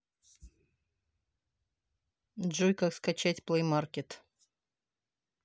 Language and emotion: Russian, neutral